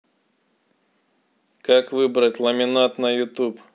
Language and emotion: Russian, neutral